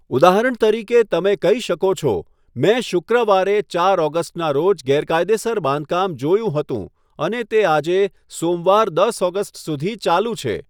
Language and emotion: Gujarati, neutral